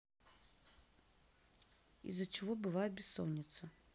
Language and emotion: Russian, neutral